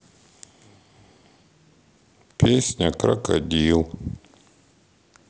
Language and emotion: Russian, sad